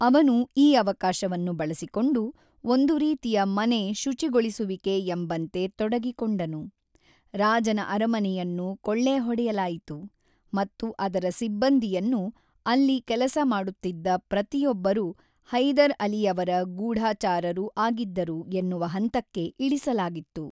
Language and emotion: Kannada, neutral